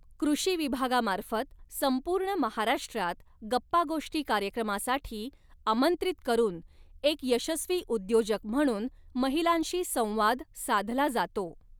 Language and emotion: Marathi, neutral